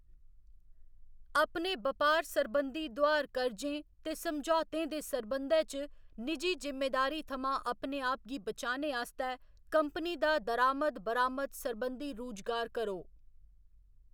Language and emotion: Dogri, neutral